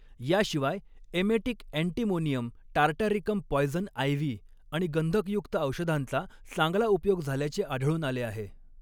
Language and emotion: Marathi, neutral